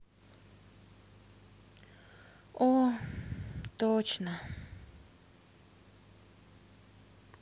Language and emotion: Russian, sad